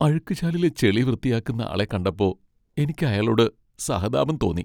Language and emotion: Malayalam, sad